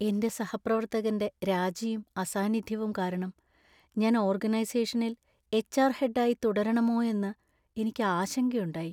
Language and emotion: Malayalam, sad